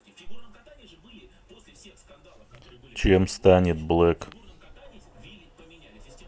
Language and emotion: Russian, neutral